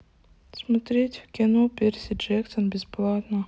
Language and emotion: Russian, neutral